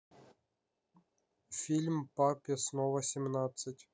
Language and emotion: Russian, neutral